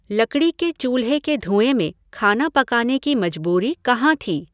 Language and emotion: Hindi, neutral